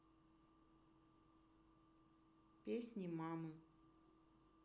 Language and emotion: Russian, neutral